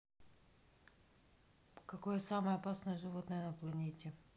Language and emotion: Russian, neutral